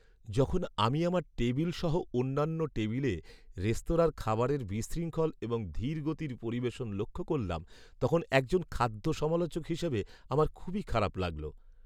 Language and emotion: Bengali, sad